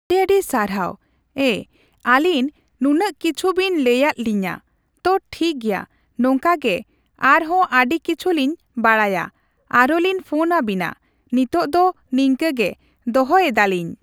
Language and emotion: Santali, neutral